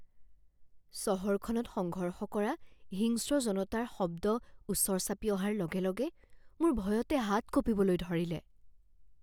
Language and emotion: Assamese, fearful